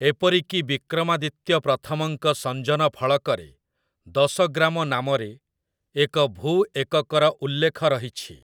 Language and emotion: Odia, neutral